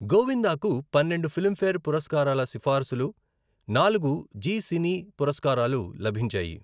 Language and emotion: Telugu, neutral